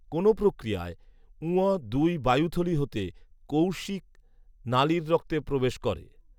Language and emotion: Bengali, neutral